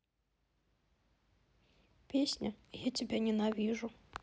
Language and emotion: Russian, sad